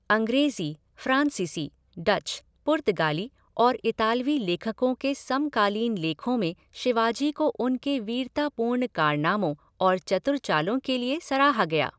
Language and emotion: Hindi, neutral